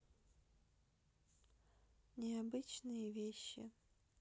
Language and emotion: Russian, neutral